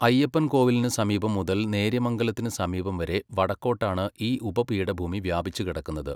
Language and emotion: Malayalam, neutral